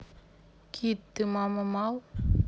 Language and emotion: Russian, neutral